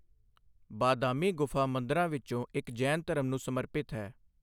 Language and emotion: Punjabi, neutral